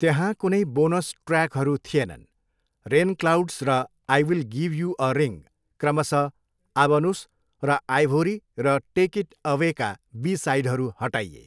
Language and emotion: Nepali, neutral